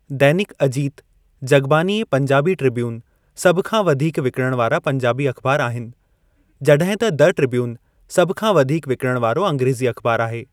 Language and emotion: Sindhi, neutral